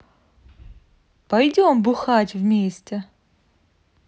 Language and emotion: Russian, positive